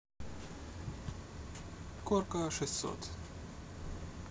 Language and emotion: Russian, neutral